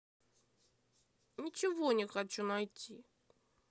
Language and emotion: Russian, angry